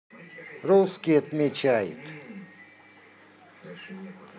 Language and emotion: Russian, neutral